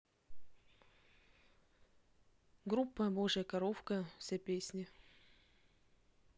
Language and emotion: Russian, neutral